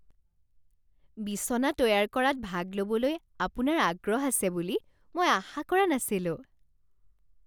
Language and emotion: Assamese, surprised